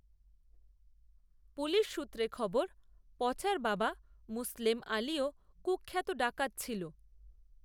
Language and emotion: Bengali, neutral